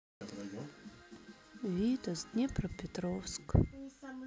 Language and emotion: Russian, sad